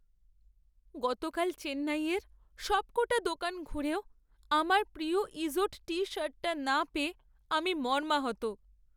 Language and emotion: Bengali, sad